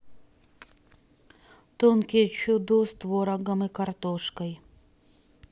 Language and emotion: Russian, neutral